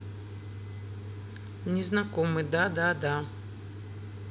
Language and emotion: Russian, neutral